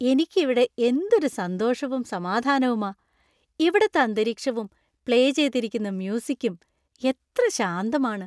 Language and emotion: Malayalam, happy